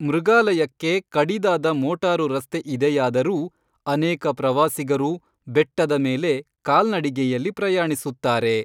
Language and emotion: Kannada, neutral